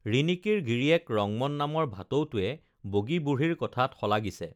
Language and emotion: Assamese, neutral